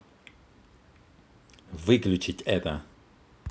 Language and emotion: Russian, angry